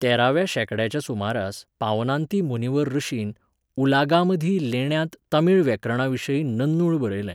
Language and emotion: Goan Konkani, neutral